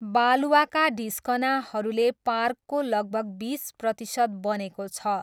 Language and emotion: Nepali, neutral